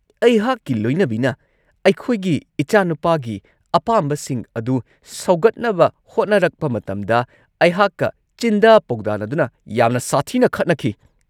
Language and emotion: Manipuri, angry